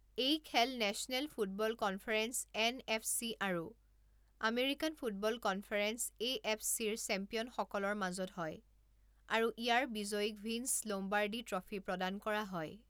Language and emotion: Assamese, neutral